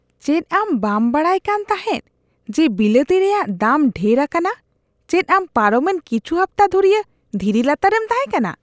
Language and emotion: Santali, disgusted